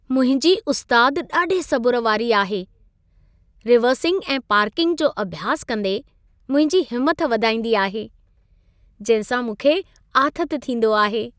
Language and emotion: Sindhi, happy